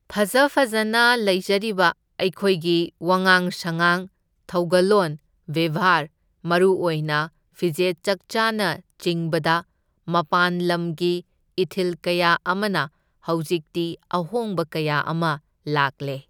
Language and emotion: Manipuri, neutral